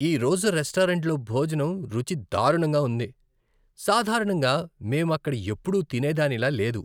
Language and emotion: Telugu, disgusted